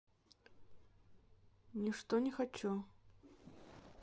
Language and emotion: Russian, neutral